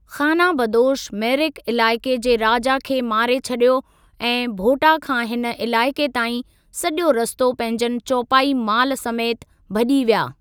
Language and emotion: Sindhi, neutral